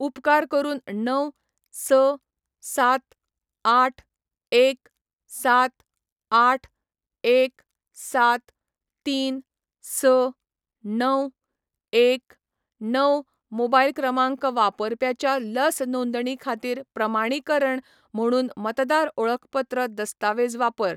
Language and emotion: Goan Konkani, neutral